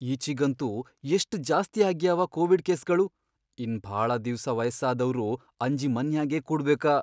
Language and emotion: Kannada, fearful